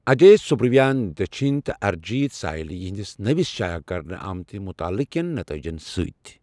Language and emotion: Kashmiri, neutral